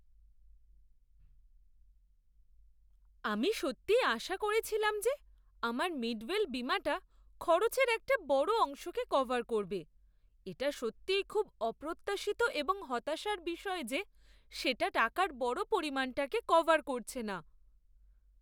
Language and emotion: Bengali, surprised